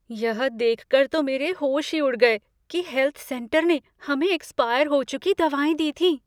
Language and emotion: Hindi, fearful